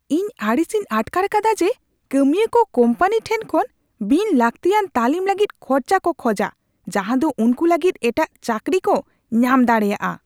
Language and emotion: Santali, angry